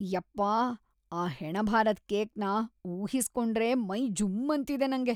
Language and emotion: Kannada, disgusted